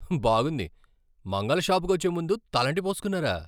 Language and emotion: Telugu, surprised